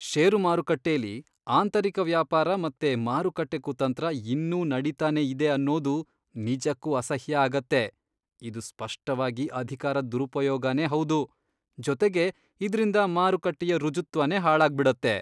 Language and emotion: Kannada, disgusted